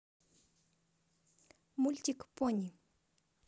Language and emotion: Russian, positive